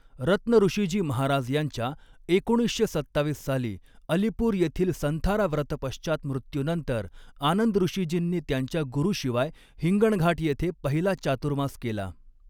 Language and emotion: Marathi, neutral